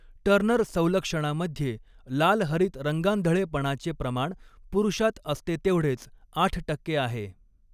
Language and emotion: Marathi, neutral